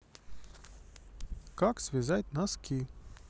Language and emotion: Russian, positive